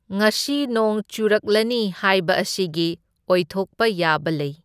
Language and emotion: Manipuri, neutral